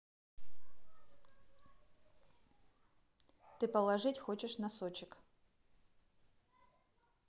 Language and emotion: Russian, neutral